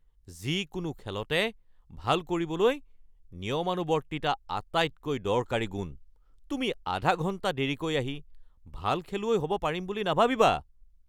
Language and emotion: Assamese, angry